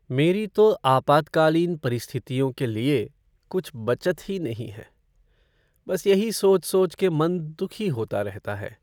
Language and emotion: Hindi, sad